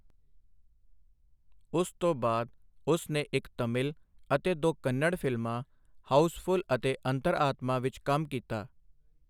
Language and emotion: Punjabi, neutral